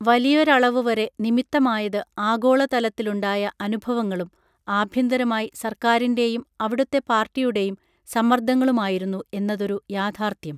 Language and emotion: Malayalam, neutral